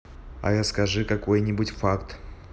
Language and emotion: Russian, neutral